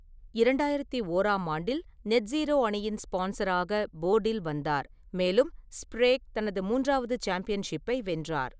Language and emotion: Tamil, neutral